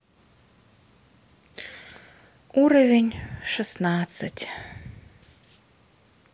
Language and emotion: Russian, sad